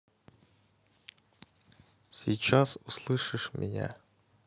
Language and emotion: Russian, neutral